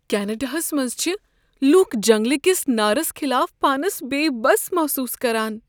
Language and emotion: Kashmiri, fearful